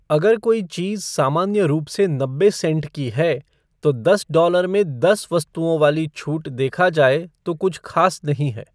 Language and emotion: Hindi, neutral